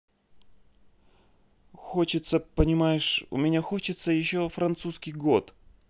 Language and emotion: Russian, neutral